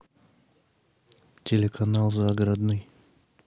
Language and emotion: Russian, neutral